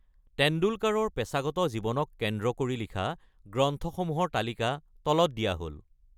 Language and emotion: Assamese, neutral